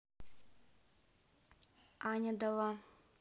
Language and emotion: Russian, neutral